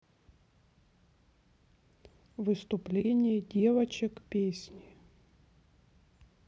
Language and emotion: Russian, neutral